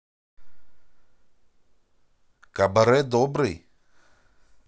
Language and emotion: Russian, positive